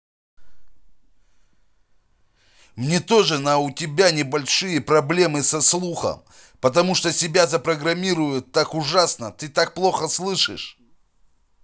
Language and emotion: Russian, angry